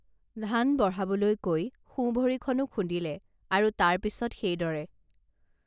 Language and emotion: Assamese, neutral